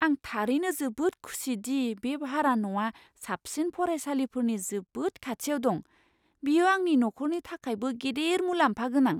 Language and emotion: Bodo, surprised